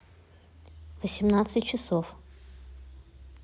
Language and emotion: Russian, neutral